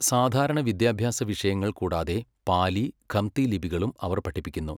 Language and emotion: Malayalam, neutral